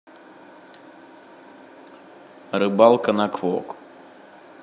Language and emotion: Russian, neutral